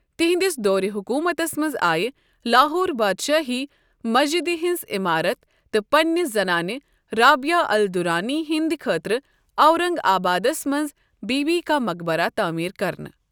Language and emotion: Kashmiri, neutral